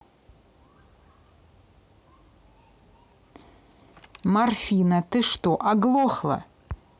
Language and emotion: Russian, angry